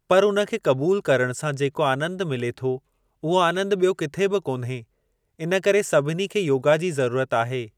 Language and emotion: Sindhi, neutral